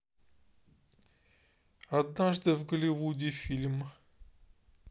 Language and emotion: Russian, neutral